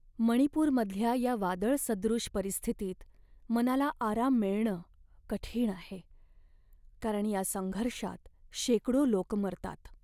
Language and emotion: Marathi, sad